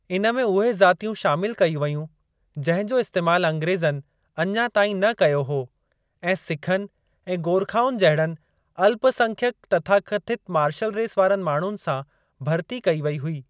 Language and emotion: Sindhi, neutral